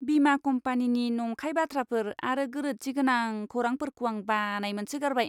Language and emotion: Bodo, disgusted